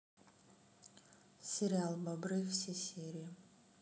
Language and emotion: Russian, neutral